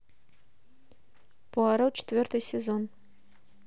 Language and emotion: Russian, neutral